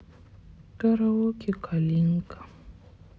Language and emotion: Russian, sad